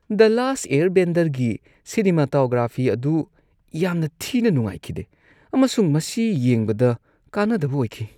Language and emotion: Manipuri, disgusted